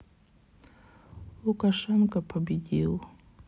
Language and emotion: Russian, sad